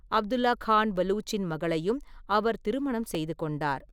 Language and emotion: Tamil, neutral